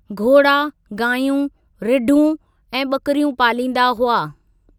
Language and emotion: Sindhi, neutral